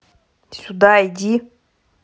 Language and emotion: Russian, angry